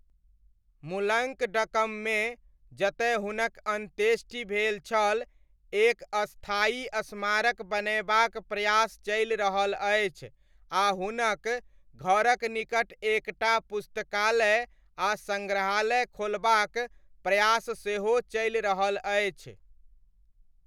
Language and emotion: Maithili, neutral